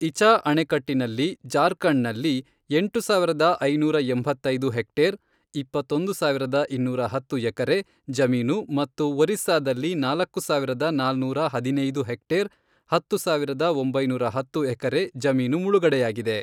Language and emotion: Kannada, neutral